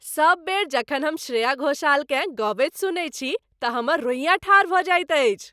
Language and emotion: Maithili, happy